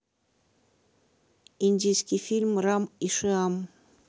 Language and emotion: Russian, neutral